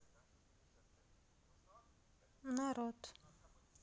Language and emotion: Russian, sad